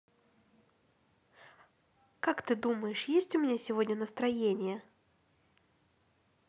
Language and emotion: Russian, neutral